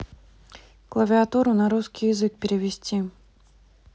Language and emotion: Russian, neutral